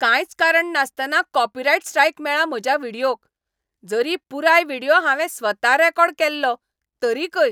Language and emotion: Goan Konkani, angry